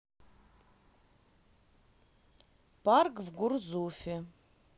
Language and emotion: Russian, neutral